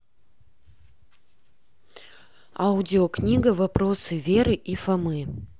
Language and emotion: Russian, neutral